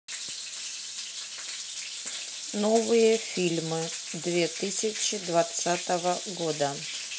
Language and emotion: Russian, neutral